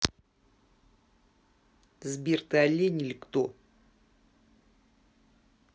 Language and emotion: Russian, angry